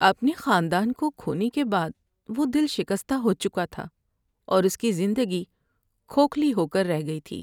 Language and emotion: Urdu, sad